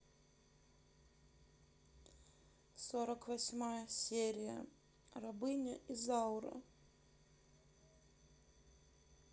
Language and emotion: Russian, sad